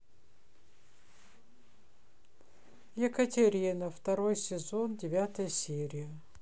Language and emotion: Russian, neutral